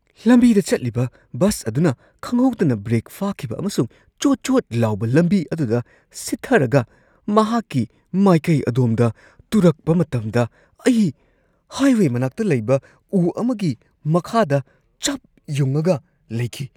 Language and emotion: Manipuri, surprised